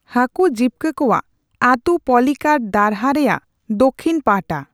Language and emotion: Santali, neutral